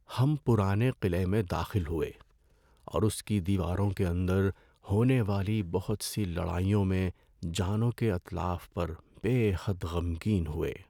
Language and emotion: Urdu, sad